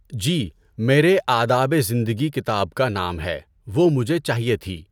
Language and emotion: Urdu, neutral